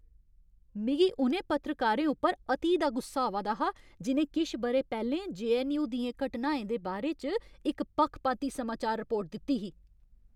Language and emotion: Dogri, angry